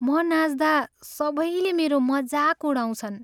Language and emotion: Nepali, sad